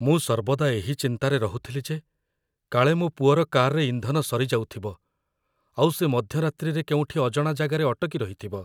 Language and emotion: Odia, fearful